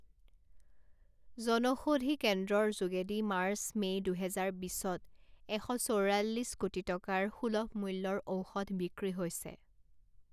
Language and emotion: Assamese, neutral